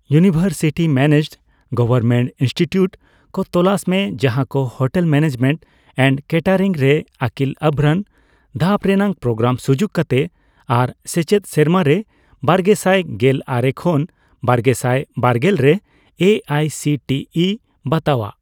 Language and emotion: Santali, neutral